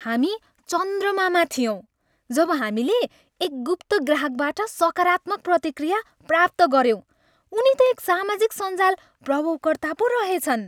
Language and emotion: Nepali, happy